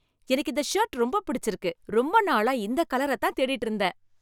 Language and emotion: Tamil, happy